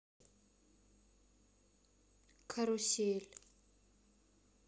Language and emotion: Russian, neutral